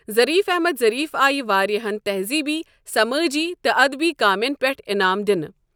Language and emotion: Kashmiri, neutral